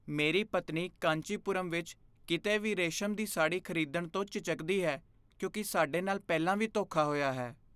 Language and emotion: Punjabi, fearful